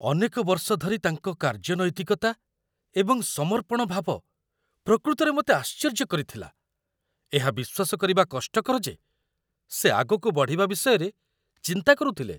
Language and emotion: Odia, surprised